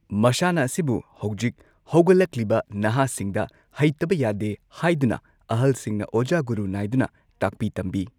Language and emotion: Manipuri, neutral